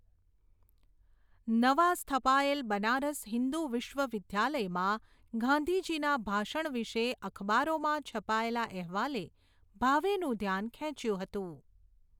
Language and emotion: Gujarati, neutral